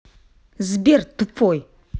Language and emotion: Russian, angry